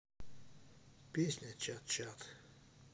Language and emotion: Russian, neutral